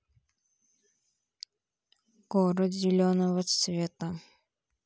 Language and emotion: Russian, sad